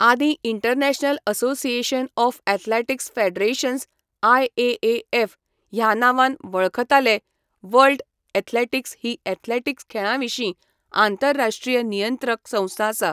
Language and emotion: Goan Konkani, neutral